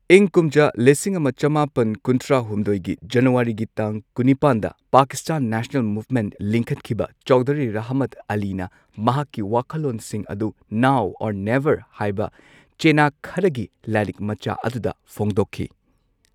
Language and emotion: Manipuri, neutral